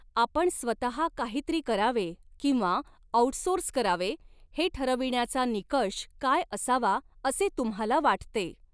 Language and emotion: Marathi, neutral